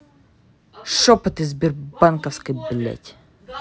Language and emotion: Russian, angry